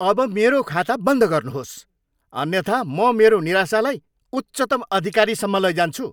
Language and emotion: Nepali, angry